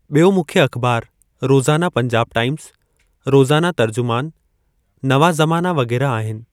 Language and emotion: Sindhi, neutral